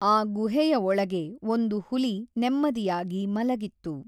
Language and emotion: Kannada, neutral